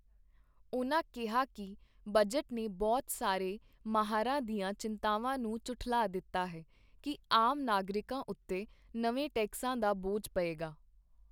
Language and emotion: Punjabi, neutral